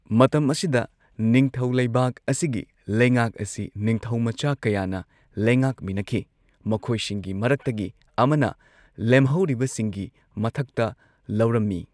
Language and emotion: Manipuri, neutral